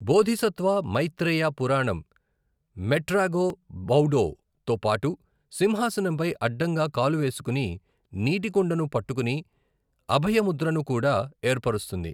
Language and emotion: Telugu, neutral